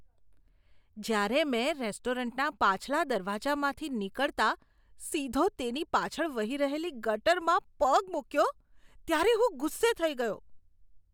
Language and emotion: Gujarati, disgusted